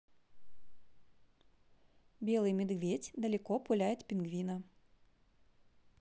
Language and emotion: Russian, positive